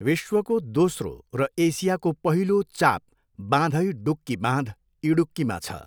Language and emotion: Nepali, neutral